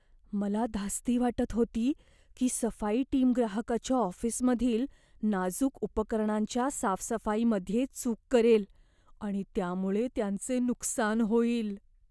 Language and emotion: Marathi, fearful